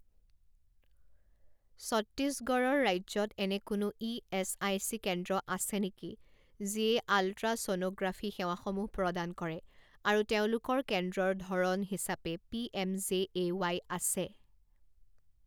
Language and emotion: Assamese, neutral